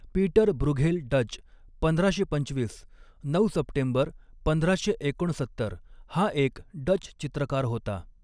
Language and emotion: Marathi, neutral